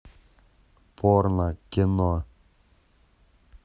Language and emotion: Russian, neutral